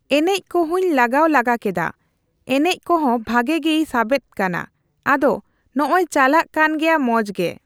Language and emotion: Santali, neutral